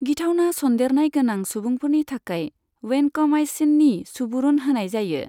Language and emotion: Bodo, neutral